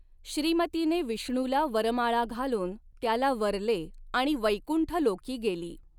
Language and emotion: Marathi, neutral